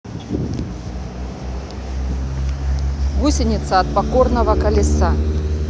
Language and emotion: Russian, neutral